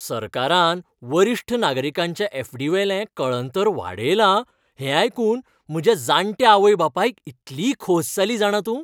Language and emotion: Goan Konkani, happy